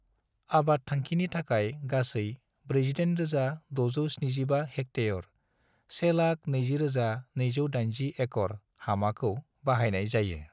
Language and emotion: Bodo, neutral